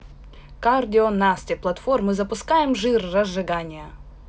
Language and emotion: Russian, neutral